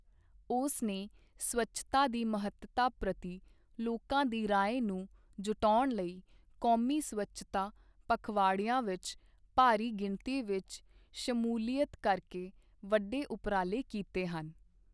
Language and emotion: Punjabi, neutral